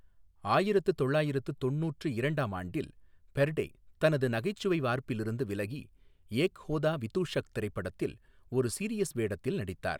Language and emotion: Tamil, neutral